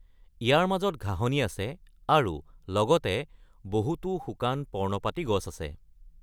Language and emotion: Assamese, neutral